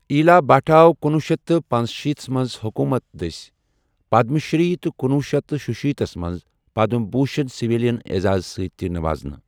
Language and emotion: Kashmiri, neutral